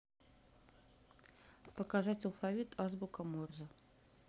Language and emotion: Russian, neutral